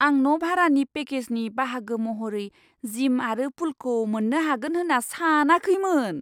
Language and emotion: Bodo, surprised